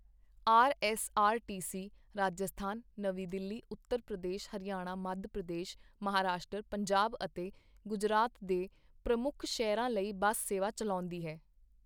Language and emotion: Punjabi, neutral